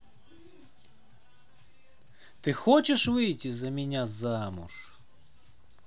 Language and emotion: Russian, neutral